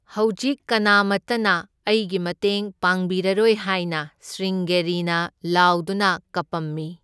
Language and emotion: Manipuri, neutral